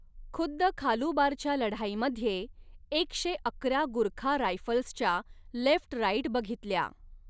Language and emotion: Marathi, neutral